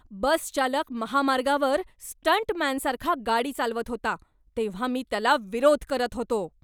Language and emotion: Marathi, angry